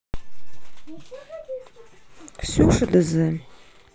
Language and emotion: Russian, neutral